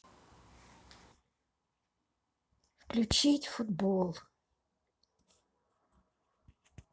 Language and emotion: Russian, sad